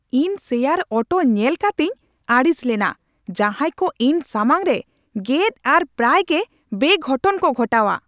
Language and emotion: Santali, angry